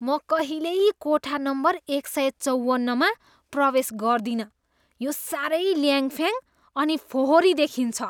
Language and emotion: Nepali, disgusted